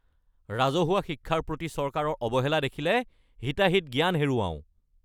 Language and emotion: Assamese, angry